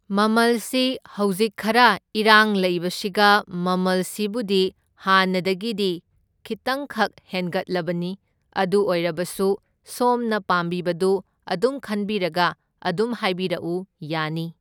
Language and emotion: Manipuri, neutral